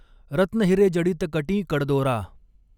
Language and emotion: Marathi, neutral